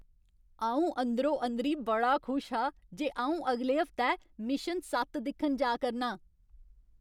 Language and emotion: Dogri, happy